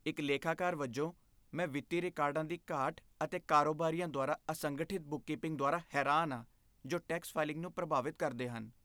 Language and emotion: Punjabi, disgusted